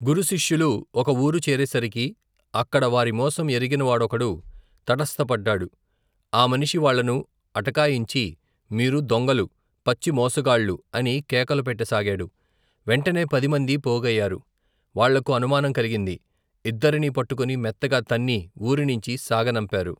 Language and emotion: Telugu, neutral